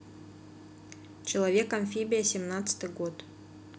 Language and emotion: Russian, neutral